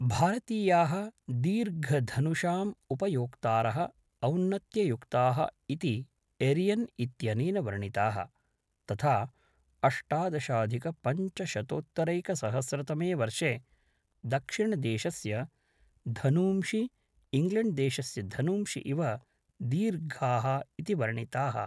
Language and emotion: Sanskrit, neutral